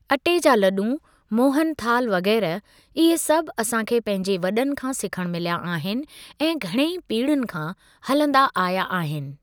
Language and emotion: Sindhi, neutral